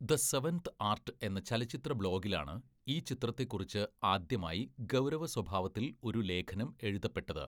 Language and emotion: Malayalam, neutral